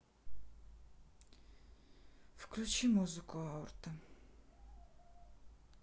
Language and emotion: Russian, sad